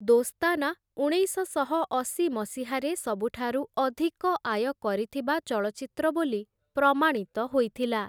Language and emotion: Odia, neutral